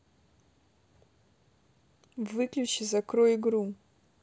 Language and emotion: Russian, neutral